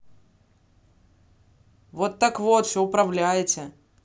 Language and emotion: Russian, neutral